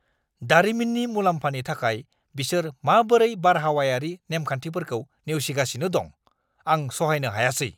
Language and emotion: Bodo, angry